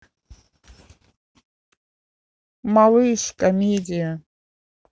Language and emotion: Russian, neutral